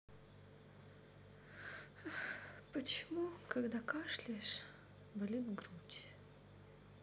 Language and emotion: Russian, sad